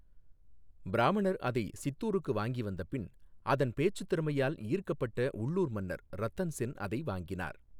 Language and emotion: Tamil, neutral